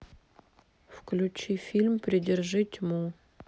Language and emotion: Russian, neutral